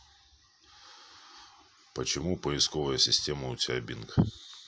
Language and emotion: Russian, neutral